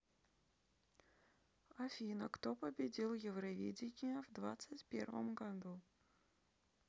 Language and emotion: Russian, neutral